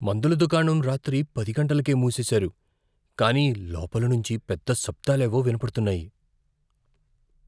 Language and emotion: Telugu, fearful